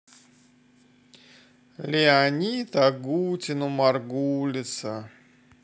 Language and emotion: Russian, sad